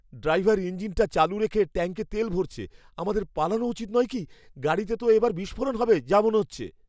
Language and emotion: Bengali, fearful